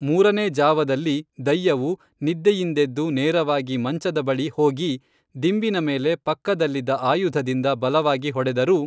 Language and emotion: Kannada, neutral